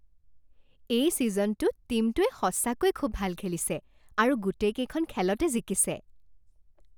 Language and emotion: Assamese, happy